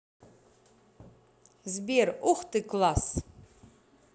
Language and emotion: Russian, positive